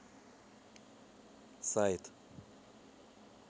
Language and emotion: Russian, neutral